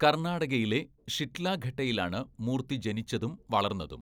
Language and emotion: Malayalam, neutral